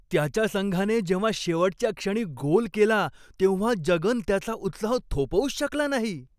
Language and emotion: Marathi, happy